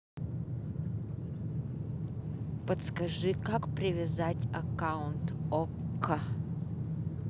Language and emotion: Russian, neutral